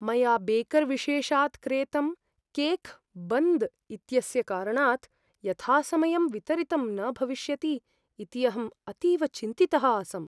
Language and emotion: Sanskrit, fearful